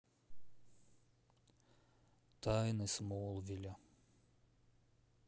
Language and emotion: Russian, sad